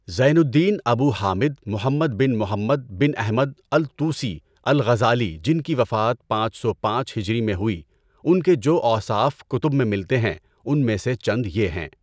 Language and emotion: Urdu, neutral